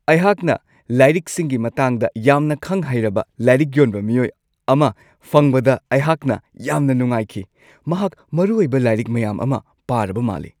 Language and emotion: Manipuri, happy